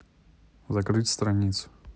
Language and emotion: Russian, neutral